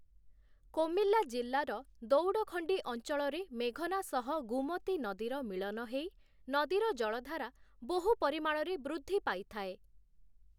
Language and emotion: Odia, neutral